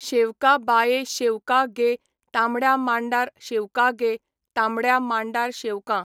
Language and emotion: Goan Konkani, neutral